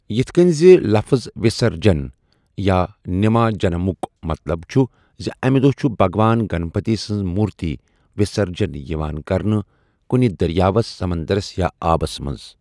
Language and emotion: Kashmiri, neutral